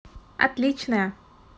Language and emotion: Russian, positive